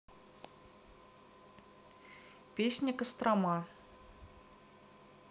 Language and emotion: Russian, neutral